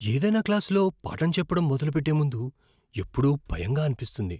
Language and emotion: Telugu, fearful